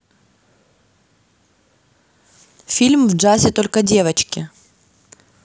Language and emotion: Russian, neutral